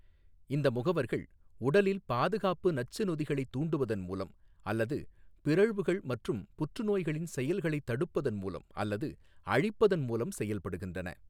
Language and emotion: Tamil, neutral